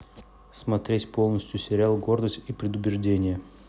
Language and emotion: Russian, neutral